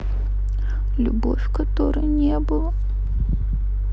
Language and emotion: Russian, sad